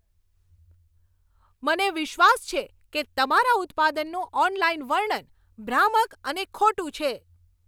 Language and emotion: Gujarati, angry